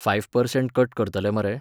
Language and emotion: Goan Konkani, neutral